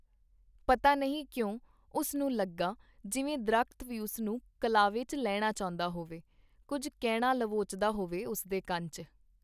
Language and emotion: Punjabi, neutral